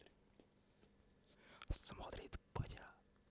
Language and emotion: Russian, positive